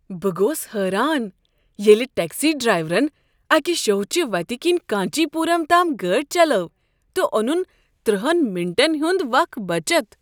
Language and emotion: Kashmiri, surprised